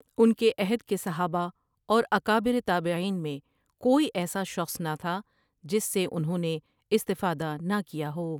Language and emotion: Urdu, neutral